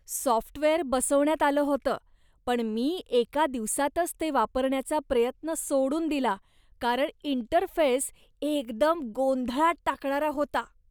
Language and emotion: Marathi, disgusted